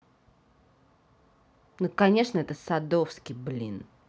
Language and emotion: Russian, angry